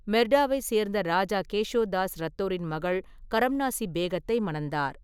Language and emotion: Tamil, neutral